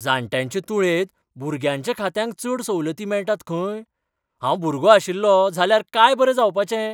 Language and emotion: Goan Konkani, surprised